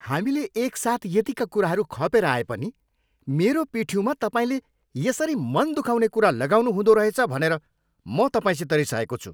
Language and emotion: Nepali, angry